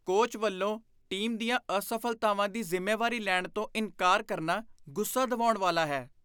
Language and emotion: Punjabi, disgusted